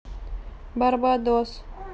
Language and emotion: Russian, neutral